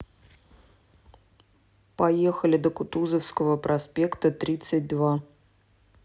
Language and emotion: Russian, neutral